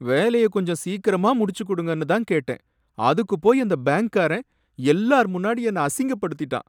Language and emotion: Tamil, sad